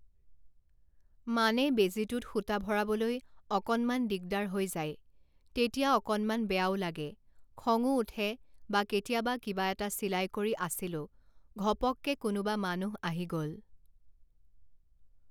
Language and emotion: Assamese, neutral